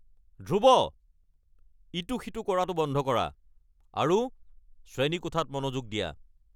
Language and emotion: Assamese, angry